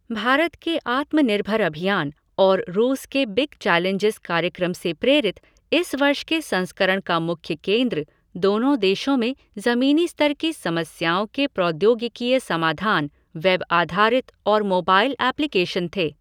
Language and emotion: Hindi, neutral